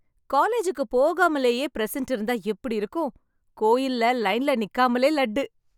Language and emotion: Tamil, happy